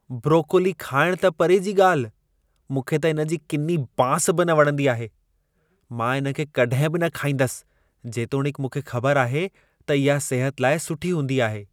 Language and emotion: Sindhi, disgusted